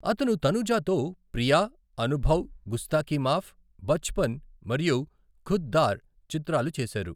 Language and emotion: Telugu, neutral